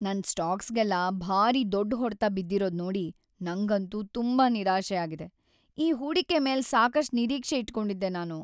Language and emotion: Kannada, sad